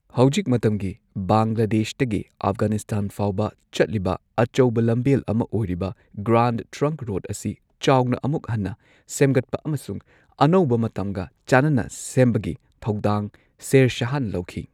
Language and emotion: Manipuri, neutral